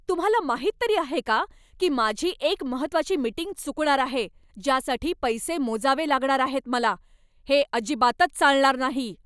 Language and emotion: Marathi, angry